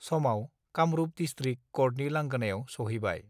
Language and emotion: Bodo, neutral